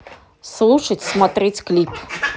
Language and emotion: Russian, neutral